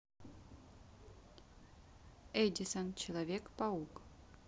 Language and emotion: Russian, neutral